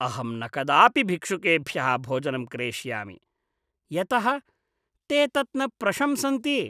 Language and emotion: Sanskrit, disgusted